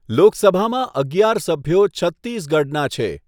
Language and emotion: Gujarati, neutral